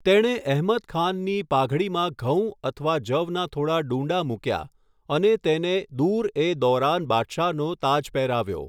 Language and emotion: Gujarati, neutral